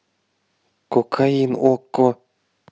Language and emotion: Russian, neutral